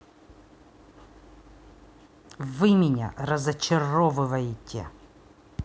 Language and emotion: Russian, angry